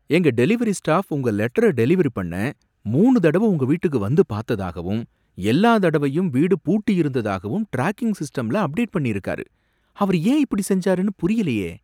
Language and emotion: Tamil, surprised